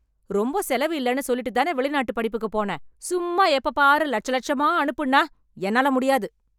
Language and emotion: Tamil, angry